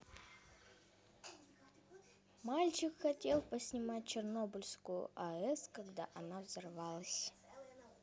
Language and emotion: Russian, neutral